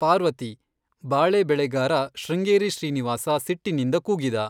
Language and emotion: Kannada, neutral